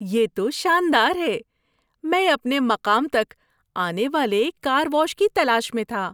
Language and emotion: Urdu, happy